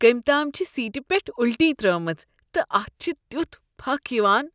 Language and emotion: Kashmiri, disgusted